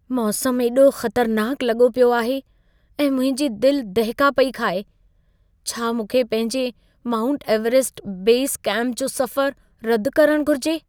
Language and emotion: Sindhi, fearful